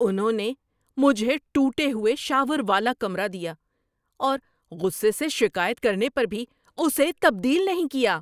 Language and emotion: Urdu, angry